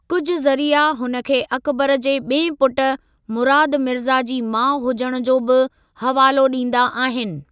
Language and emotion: Sindhi, neutral